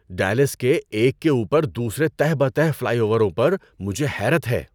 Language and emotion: Urdu, surprised